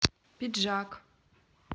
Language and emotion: Russian, neutral